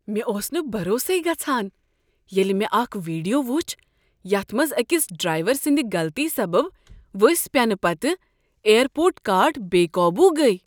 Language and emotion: Kashmiri, surprised